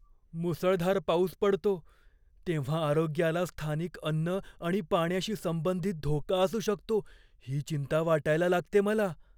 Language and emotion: Marathi, fearful